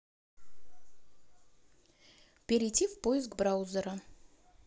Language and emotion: Russian, neutral